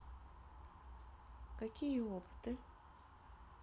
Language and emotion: Russian, neutral